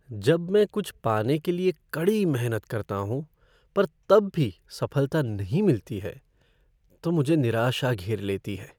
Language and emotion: Hindi, sad